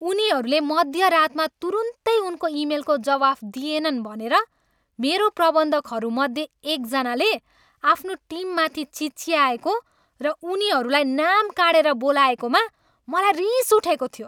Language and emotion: Nepali, angry